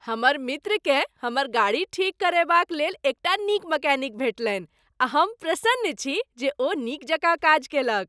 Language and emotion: Maithili, happy